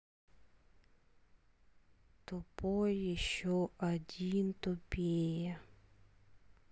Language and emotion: Russian, sad